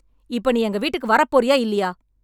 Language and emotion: Tamil, angry